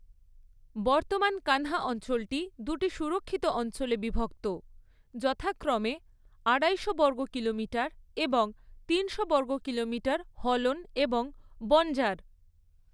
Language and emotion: Bengali, neutral